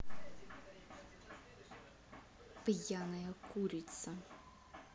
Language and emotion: Russian, angry